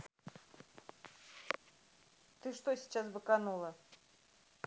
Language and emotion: Russian, angry